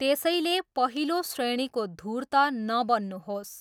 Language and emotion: Nepali, neutral